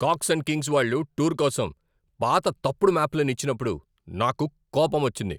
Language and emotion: Telugu, angry